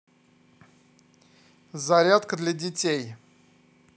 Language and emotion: Russian, neutral